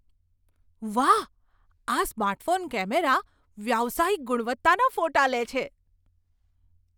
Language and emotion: Gujarati, surprised